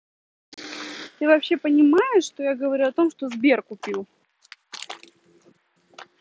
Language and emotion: Russian, angry